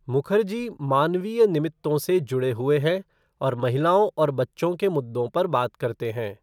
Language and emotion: Hindi, neutral